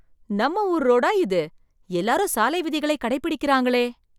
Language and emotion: Tamil, surprised